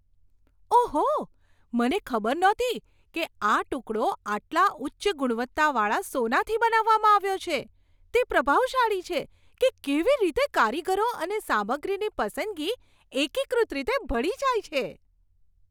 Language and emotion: Gujarati, surprised